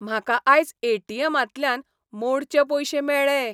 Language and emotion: Goan Konkani, happy